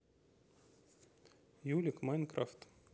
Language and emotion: Russian, neutral